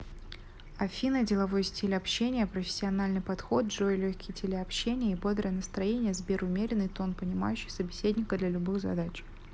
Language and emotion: Russian, neutral